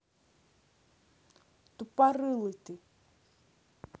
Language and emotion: Russian, angry